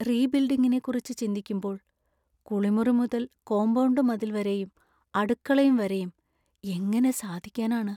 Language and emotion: Malayalam, sad